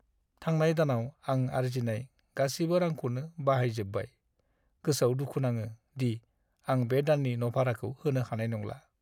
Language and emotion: Bodo, sad